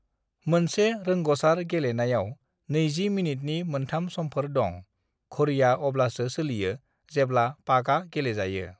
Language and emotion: Bodo, neutral